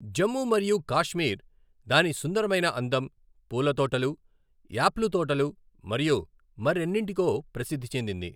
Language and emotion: Telugu, neutral